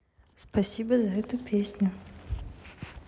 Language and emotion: Russian, neutral